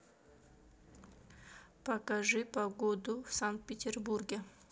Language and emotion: Russian, neutral